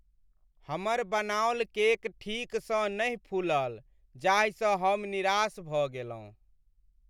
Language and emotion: Maithili, sad